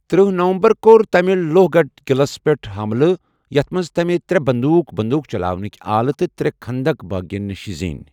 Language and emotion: Kashmiri, neutral